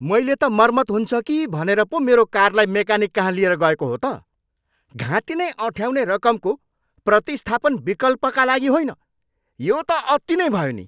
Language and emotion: Nepali, angry